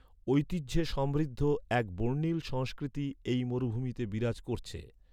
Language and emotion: Bengali, neutral